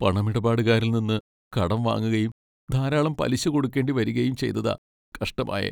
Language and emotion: Malayalam, sad